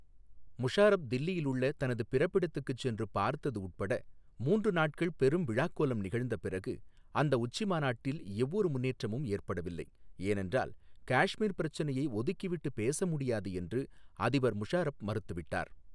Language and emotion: Tamil, neutral